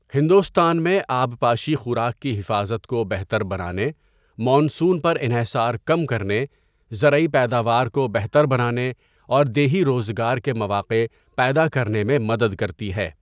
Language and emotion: Urdu, neutral